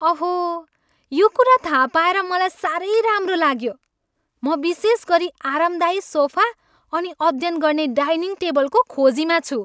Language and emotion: Nepali, happy